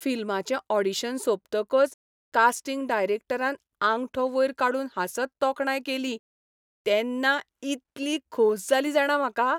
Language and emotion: Goan Konkani, happy